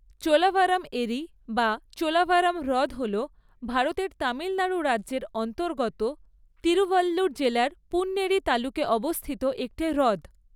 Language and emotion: Bengali, neutral